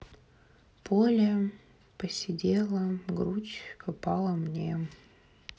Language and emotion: Russian, sad